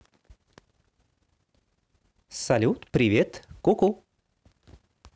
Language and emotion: Russian, positive